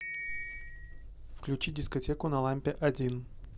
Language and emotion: Russian, neutral